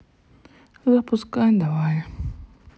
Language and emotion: Russian, sad